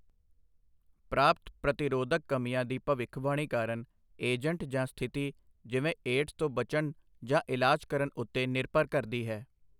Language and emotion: Punjabi, neutral